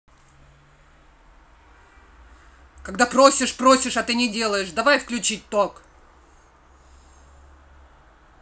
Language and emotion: Russian, angry